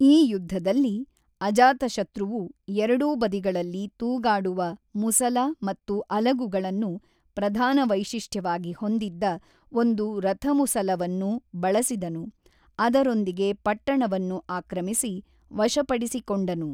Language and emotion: Kannada, neutral